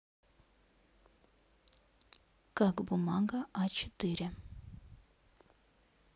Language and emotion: Russian, neutral